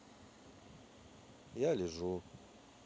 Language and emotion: Russian, neutral